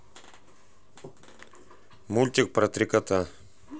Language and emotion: Russian, neutral